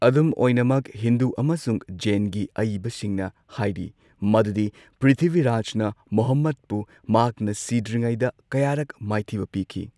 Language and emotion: Manipuri, neutral